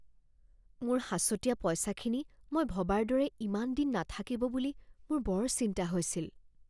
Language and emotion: Assamese, fearful